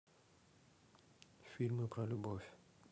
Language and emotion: Russian, neutral